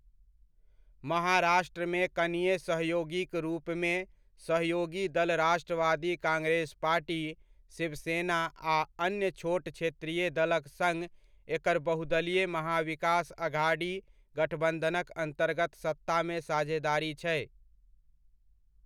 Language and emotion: Maithili, neutral